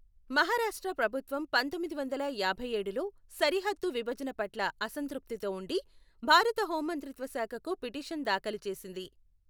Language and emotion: Telugu, neutral